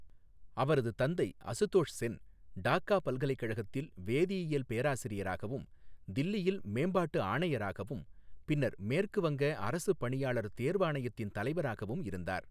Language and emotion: Tamil, neutral